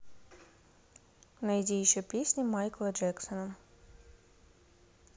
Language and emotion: Russian, neutral